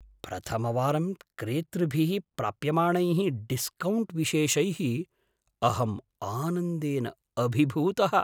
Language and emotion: Sanskrit, surprised